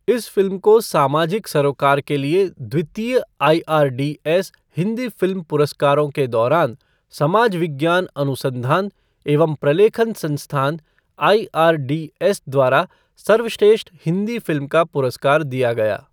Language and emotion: Hindi, neutral